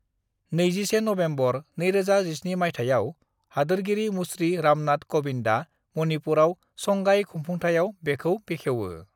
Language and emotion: Bodo, neutral